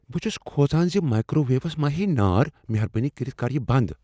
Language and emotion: Kashmiri, fearful